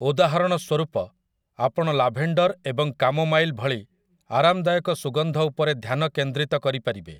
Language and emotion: Odia, neutral